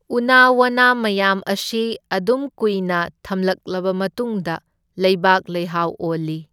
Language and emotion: Manipuri, neutral